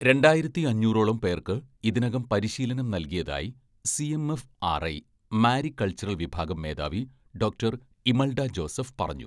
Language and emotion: Malayalam, neutral